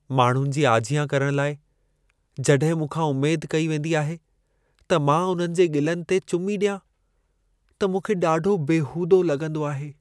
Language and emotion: Sindhi, sad